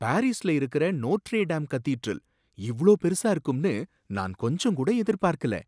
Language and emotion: Tamil, surprised